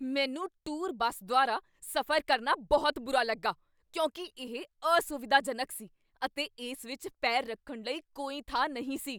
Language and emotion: Punjabi, angry